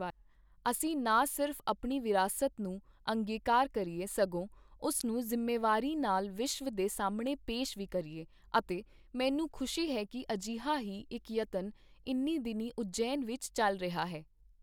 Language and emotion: Punjabi, neutral